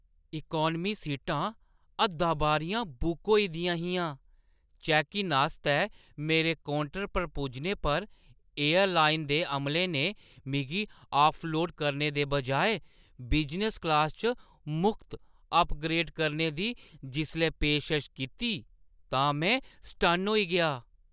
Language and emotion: Dogri, surprised